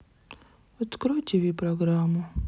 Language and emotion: Russian, sad